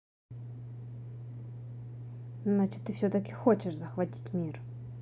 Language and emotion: Russian, neutral